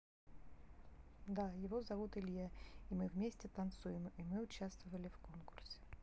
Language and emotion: Russian, neutral